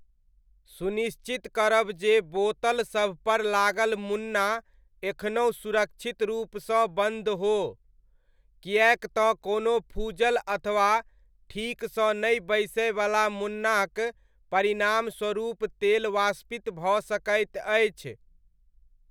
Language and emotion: Maithili, neutral